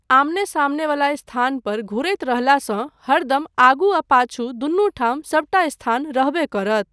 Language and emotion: Maithili, neutral